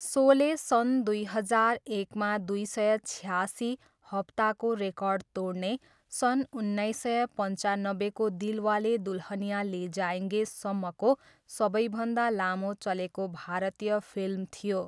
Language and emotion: Nepali, neutral